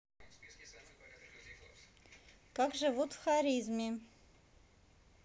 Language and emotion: Russian, positive